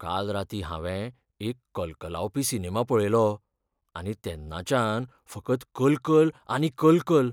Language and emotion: Goan Konkani, fearful